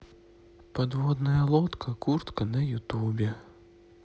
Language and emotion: Russian, sad